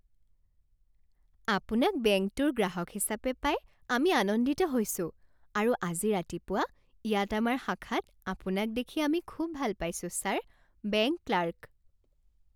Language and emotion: Assamese, happy